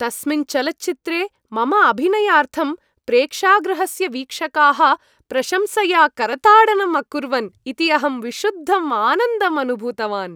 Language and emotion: Sanskrit, happy